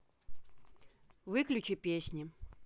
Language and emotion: Russian, neutral